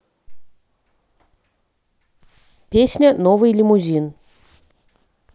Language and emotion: Russian, neutral